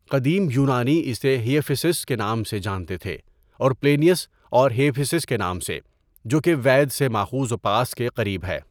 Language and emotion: Urdu, neutral